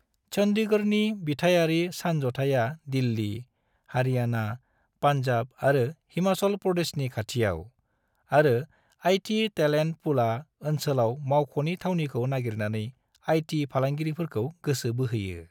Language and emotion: Bodo, neutral